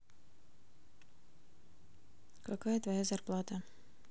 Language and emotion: Russian, neutral